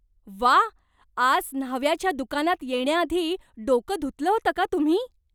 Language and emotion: Marathi, surprised